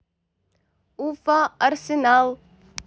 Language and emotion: Russian, neutral